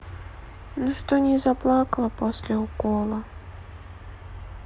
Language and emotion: Russian, sad